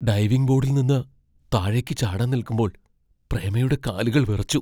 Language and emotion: Malayalam, fearful